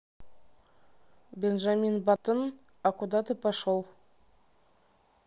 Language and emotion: Russian, neutral